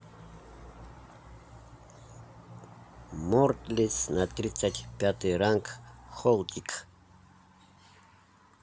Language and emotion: Russian, neutral